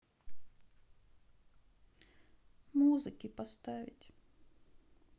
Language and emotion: Russian, sad